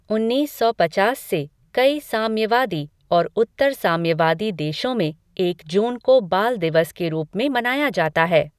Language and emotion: Hindi, neutral